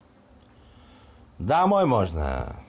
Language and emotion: Russian, positive